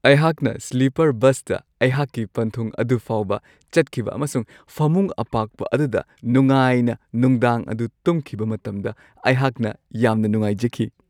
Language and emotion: Manipuri, happy